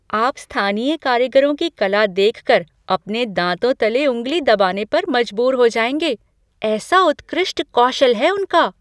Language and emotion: Hindi, surprised